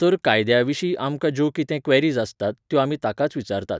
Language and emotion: Goan Konkani, neutral